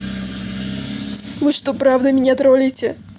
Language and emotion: Russian, positive